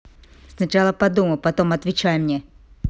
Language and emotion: Russian, angry